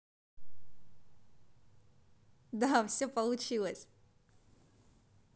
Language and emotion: Russian, positive